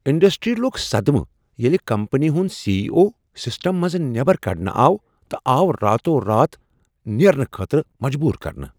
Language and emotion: Kashmiri, surprised